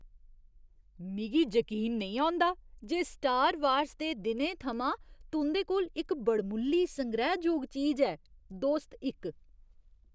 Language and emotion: Dogri, surprised